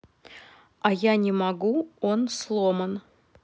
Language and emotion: Russian, neutral